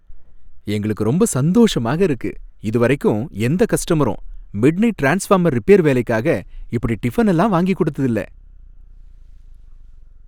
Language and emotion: Tamil, happy